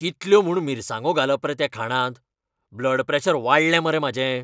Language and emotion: Goan Konkani, angry